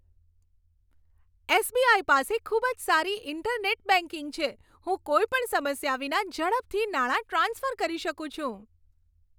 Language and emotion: Gujarati, happy